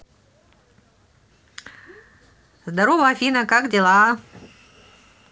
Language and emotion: Russian, positive